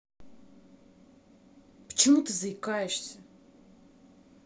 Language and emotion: Russian, angry